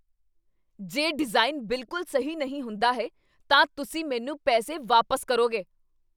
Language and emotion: Punjabi, angry